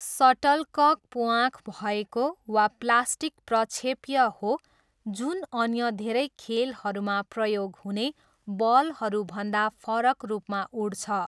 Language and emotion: Nepali, neutral